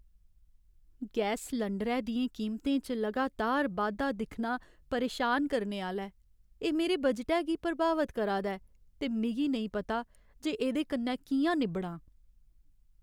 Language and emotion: Dogri, sad